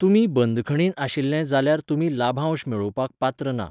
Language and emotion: Goan Konkani, neutral